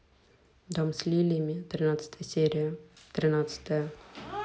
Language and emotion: Russian, neutral